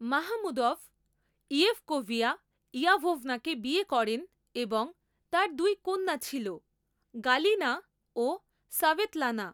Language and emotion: Bengali, neutral